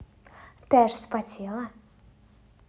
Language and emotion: Russian, positive